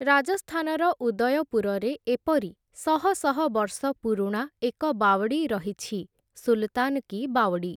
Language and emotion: Odia, neutral